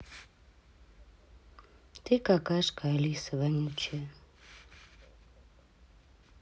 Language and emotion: Russian, angry